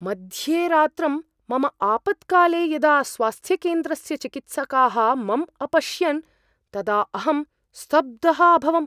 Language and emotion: Sanskrit, surprised